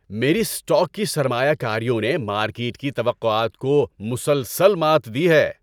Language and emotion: Urdu, happy